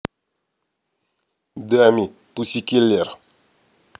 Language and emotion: Russian, neutral